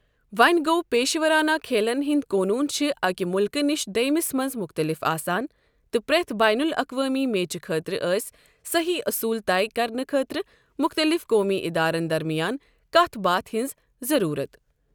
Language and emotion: Kashmiri, neutral